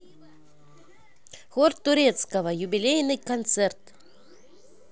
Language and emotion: Russian, positive